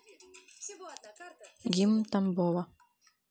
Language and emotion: Russian, neutral